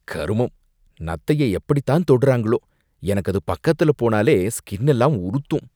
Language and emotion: Tamil, disgusted